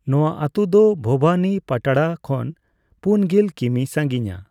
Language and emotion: Santali, neutral